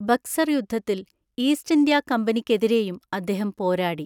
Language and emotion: Malayalam, neutral